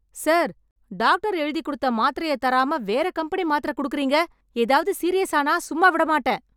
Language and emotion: Tamil, angry